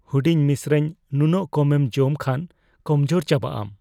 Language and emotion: Santali, fearful